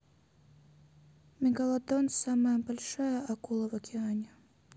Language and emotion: Russian, neutral